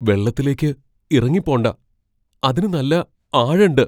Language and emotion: Malayalam, fearful